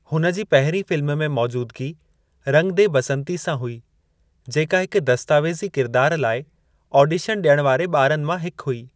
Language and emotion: Sindhi, neutral